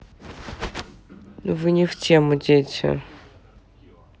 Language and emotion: Russian, neutral